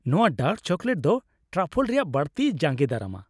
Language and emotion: Santali, happy